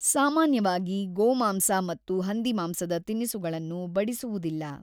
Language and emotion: Kannada, neutral